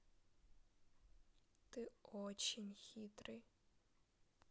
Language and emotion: Russian, sad